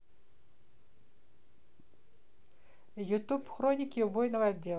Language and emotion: Russian, neutral